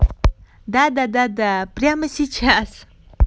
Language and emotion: Russian, positive